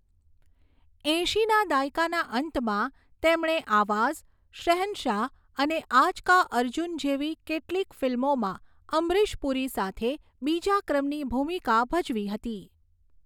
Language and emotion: Gujarati, neutral